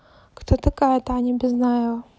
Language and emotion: Russian, neutral